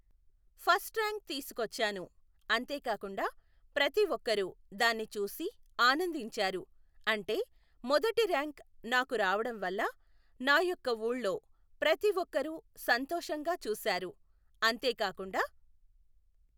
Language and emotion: Telugu, neutral